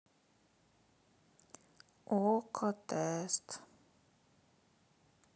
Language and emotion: Russian, sad